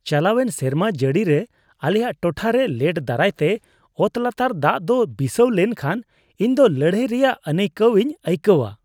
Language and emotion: Santali, disgusted